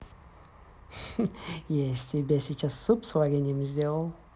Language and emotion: Russian, positive